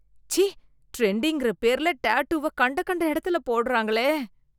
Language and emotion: Tamil, disgusted